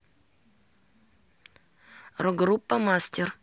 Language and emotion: Russian, neutral